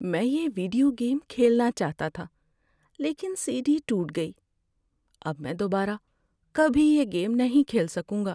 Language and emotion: Urdu, sad